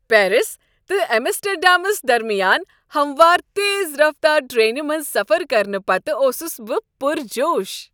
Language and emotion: Kashmiri, happy